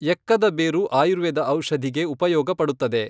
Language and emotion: Kannada, neutral